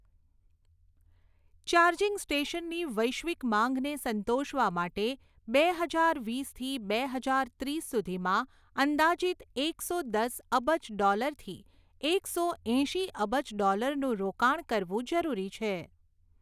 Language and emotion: Gujarati, neutral